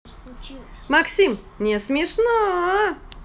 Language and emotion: Russian, positive